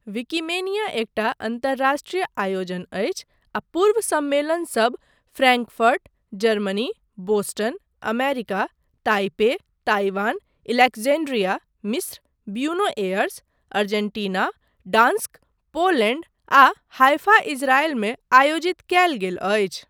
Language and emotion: Maithili, neutral